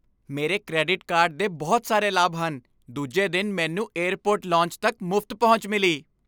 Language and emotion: Punjabi, happy